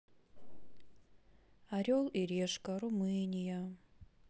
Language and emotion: Russian, sad